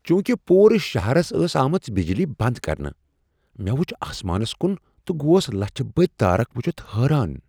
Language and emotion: Kashmiri, surprised